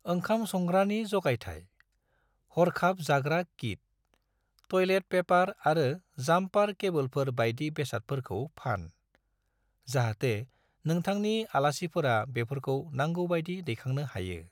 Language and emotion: Bodo, neutral